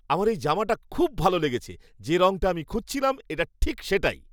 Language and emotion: Bengali, happy